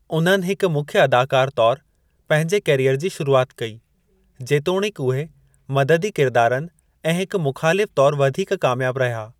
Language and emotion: Sindhi, neutral